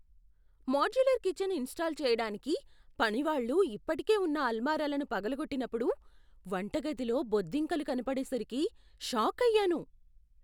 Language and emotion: Telugu, surprised